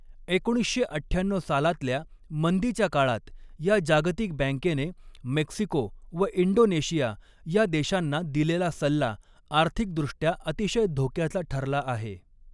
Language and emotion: Marathi, neutral